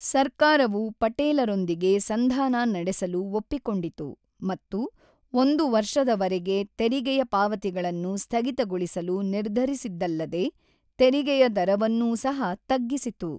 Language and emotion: Kannada, neutral